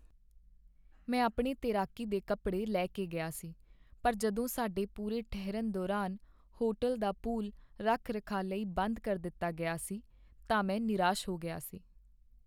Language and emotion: Punjabi, sad